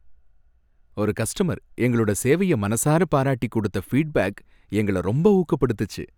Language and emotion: Tamil, happy